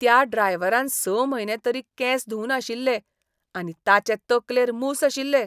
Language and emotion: Goan Konkani, disgusted